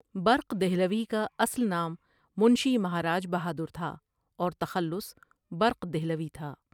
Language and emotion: Urdu, neutral